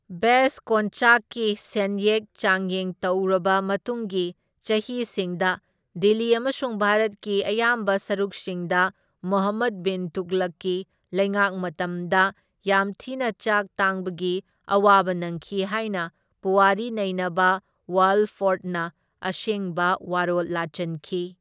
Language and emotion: Manipuri, neutral